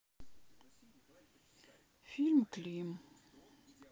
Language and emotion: Russian, sad